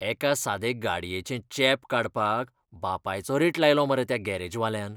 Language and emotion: Goan Konkani, disgusted